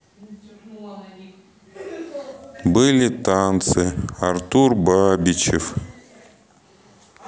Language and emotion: Russian, sad